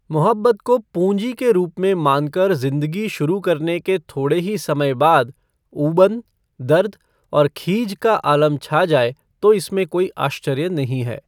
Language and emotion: Hindi, neutral